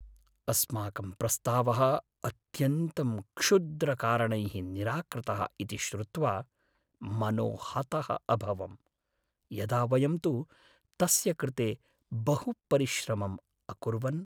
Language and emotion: Sanskrit, sad